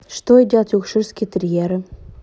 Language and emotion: Russian, neutral